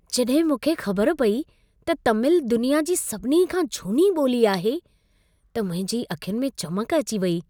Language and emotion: Sindhi, happy